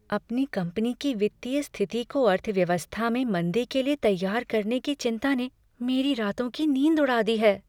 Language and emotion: Hindi, fearful